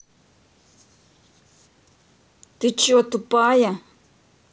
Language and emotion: Russian, angry